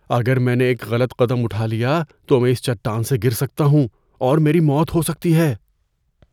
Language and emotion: Urdu, fearful